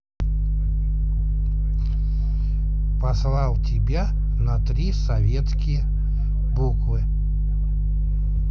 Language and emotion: Russian, neutral